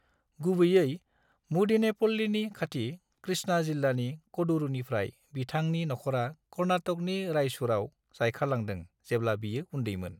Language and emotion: Bodo, neutral